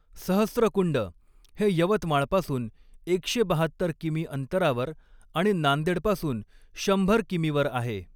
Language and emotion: Marathi, neutral